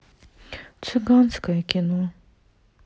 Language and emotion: Russian, sad